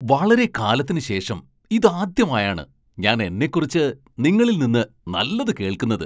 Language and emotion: Malayalam, surprised